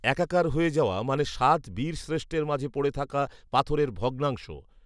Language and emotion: Bengali, neutral